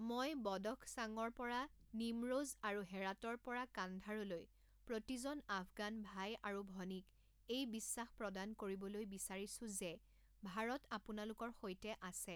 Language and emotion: Assamese, neutral